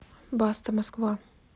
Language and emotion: Russian, neutral